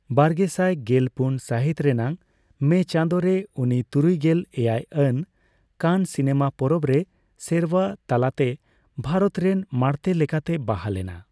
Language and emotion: Santali, neutral